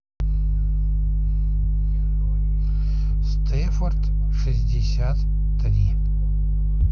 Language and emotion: Russian, neutral